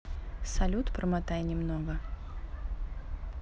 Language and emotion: Russian, neutral